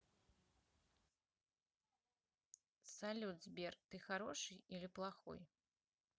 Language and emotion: Russian, neutral